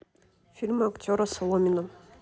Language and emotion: Russian, neutral